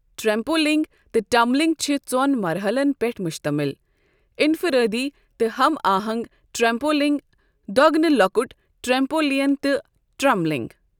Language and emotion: Kashmiri, neutral